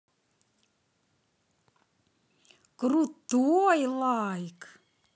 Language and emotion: Russian, positive